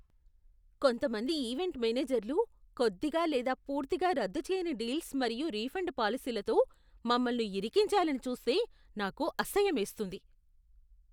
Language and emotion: Telugu, disgusted